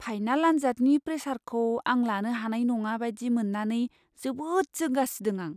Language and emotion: Bodo, fearful